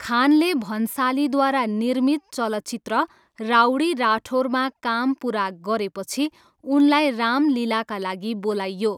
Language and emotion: Nepali, neutral